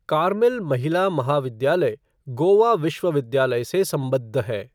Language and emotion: Hindi, neutral